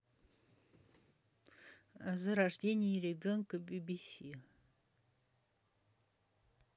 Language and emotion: Russian, neutral